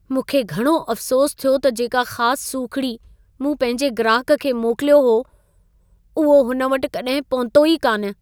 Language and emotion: Sindhi, sad